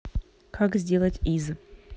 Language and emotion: Russian, neutral